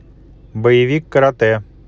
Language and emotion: Russian, neutral